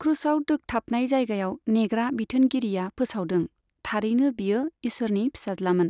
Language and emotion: Bodo, neutral